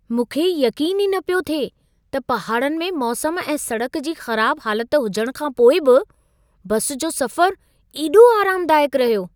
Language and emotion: Sindhi, surprised